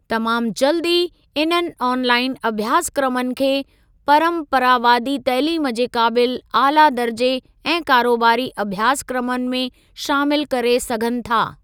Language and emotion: Sindhi, neutral